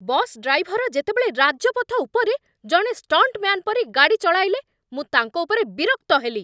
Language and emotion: Odia, angry